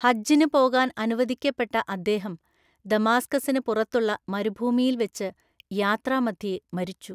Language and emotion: Malayalam, neutral